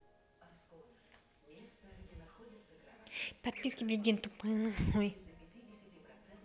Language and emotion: Russian, neutral